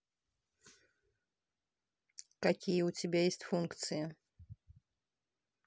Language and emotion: Russian, neutral